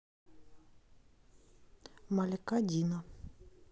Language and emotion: Russian, neutral